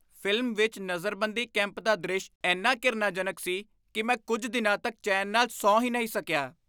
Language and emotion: Punjabi, disgusted